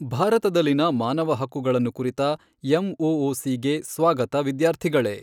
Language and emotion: Kannada, neutral